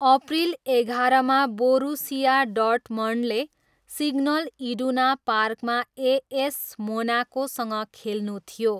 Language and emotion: Nepali, neutral